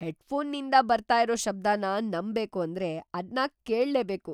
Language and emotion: Kannada, surprised